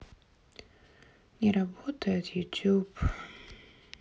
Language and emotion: Russian, sad